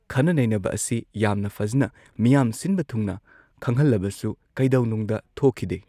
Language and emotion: Manipuri, neutral